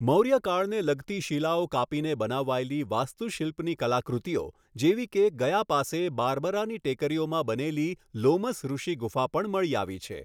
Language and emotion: Gujarati, neutral